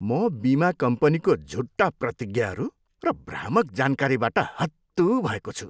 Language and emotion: Nepali, disgusted